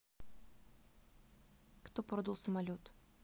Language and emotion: Russian, neutral